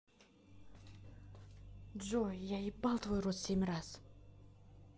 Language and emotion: Russian, angry